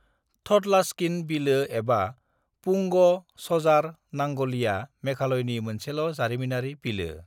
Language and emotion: Bodo, neutral